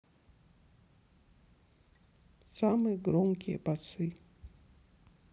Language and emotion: Russian, sad